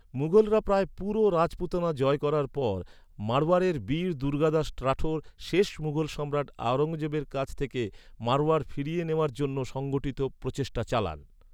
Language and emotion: Bengali, neutral